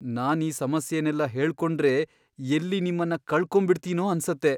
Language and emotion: Kannada, fearful